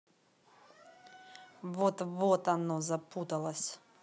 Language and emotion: Russian, angry